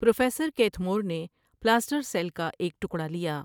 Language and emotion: Urdu, neutral